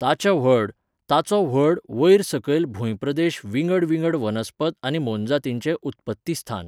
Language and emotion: Goan Konkani, neutral